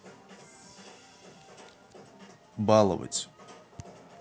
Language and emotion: Russian, neutral